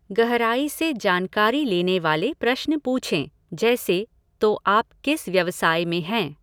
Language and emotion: Hindi, neutral